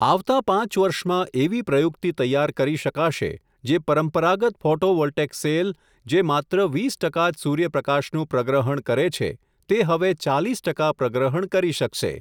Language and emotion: Gujarati, neutral